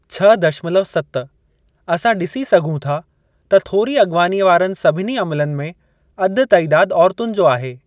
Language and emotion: Sindhi, neutral